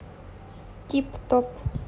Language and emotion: Russian, neutral